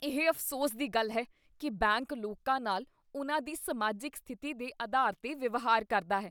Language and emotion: Punjabi, disgusted